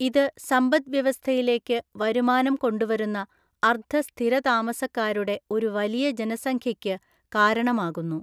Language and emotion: Malayalam, neutral